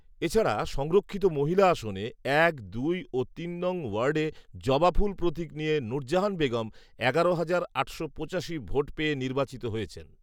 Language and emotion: Bengali, neutral